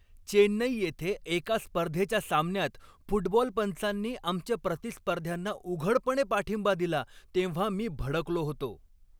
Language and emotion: Marathi, angry